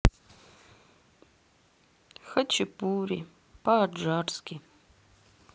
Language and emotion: Russian, sad